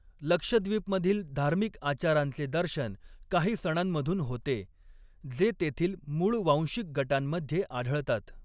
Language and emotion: Marathi, neutral